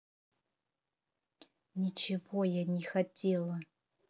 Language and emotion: Russian, angry